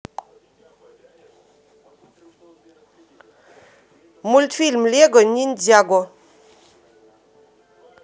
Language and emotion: Russian, neutral